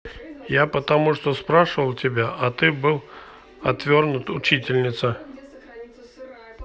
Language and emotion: Russian, neutral